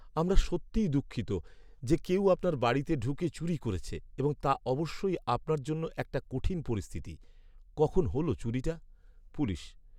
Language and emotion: Bengali, sad